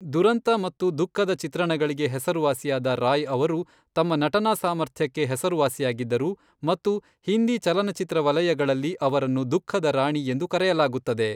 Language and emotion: Kannada, neutral